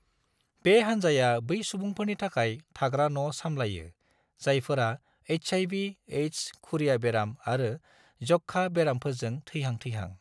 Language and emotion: Bodo, neutral